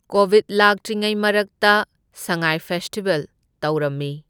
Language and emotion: Manipuri, neutral